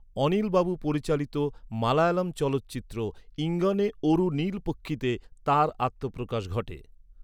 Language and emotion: Bengali, neutral